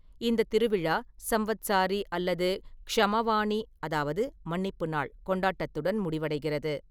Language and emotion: Tamil, neutral